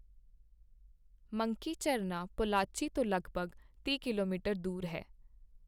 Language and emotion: Punjabi, neutral